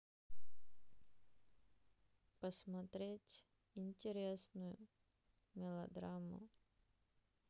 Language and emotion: Russian, sad